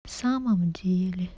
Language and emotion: Russian, sad